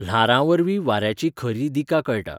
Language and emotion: Goan Konkani, neutral